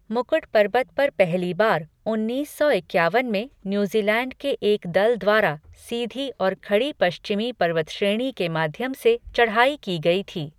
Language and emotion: Hindi, neutral